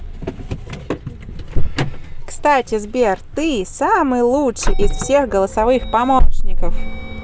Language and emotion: Russian, positive